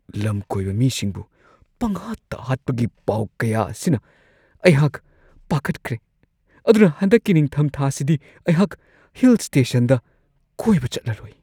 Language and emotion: Manipuri, fearful